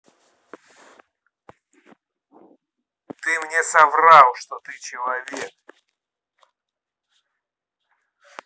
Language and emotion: Russian, angry